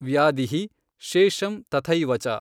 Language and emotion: Kannada, neutral